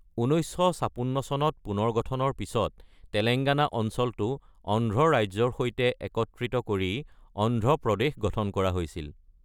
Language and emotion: Assamese, neutral